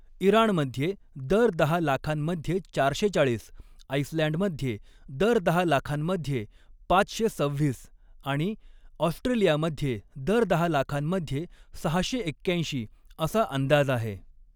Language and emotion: Marathi, neutral